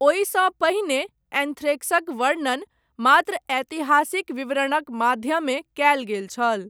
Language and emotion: Maithili, neutral